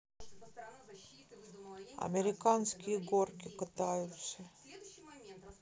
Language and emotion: Russian, sad